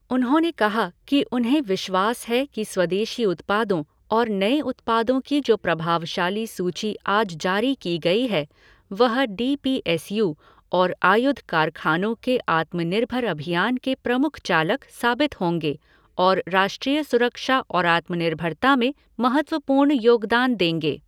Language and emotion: Hindi, neutral